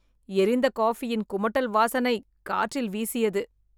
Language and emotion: Tamil, disgusted